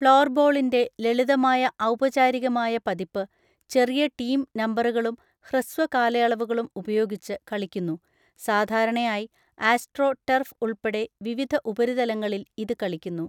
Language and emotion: Malayalam, neutral